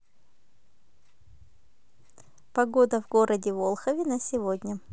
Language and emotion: Russian, positive